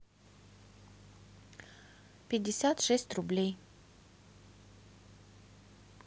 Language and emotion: Russian, neutral